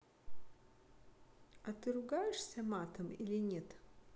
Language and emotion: Russian, neutral